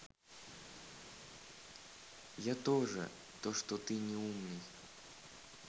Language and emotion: Russian, sad